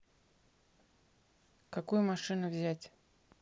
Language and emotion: Russian, neutral